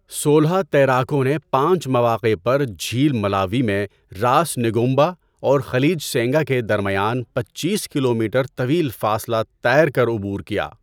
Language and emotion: Urdu, neutral